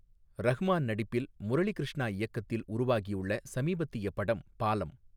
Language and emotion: Tamil, neutral